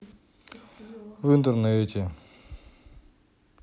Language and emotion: Russian, sad